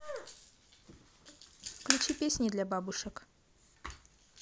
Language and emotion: Russian, neutral